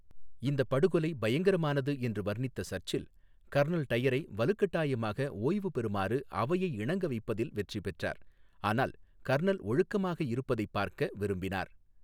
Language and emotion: Tamil, neutral